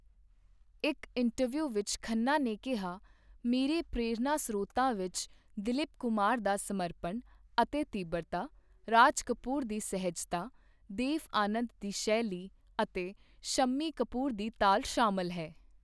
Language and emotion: Punjabi, neutral